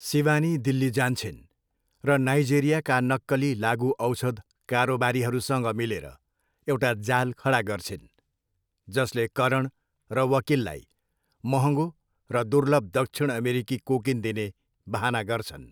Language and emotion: Nepali, neutral